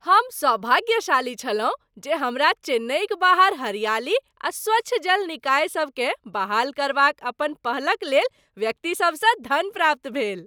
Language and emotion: Maithili, happy